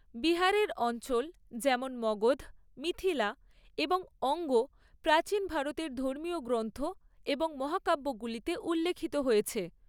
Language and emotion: Bengali, neutral